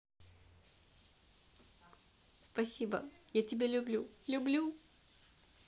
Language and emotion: Russian, positive